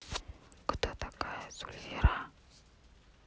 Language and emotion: Russian, neutral